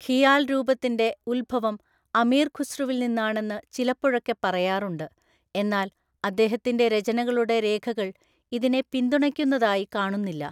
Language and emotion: Malayalam, neutral